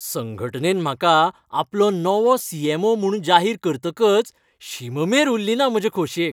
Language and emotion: Goan Konkani, happy